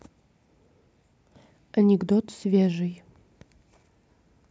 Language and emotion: Russian, neutral